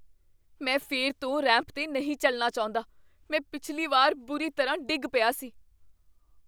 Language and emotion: Punjabi, fearful